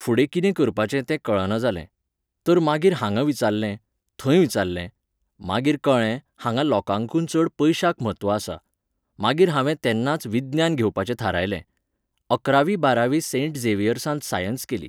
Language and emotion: Goan Konkani, neutral